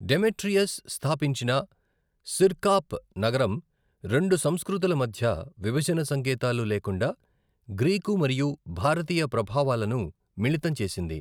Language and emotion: Telugu, neutral